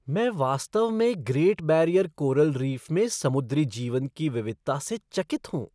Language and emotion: Hindi, surprised